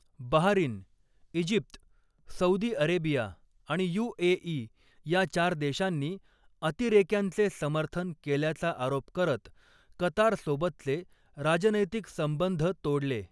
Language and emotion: Marathi, neutral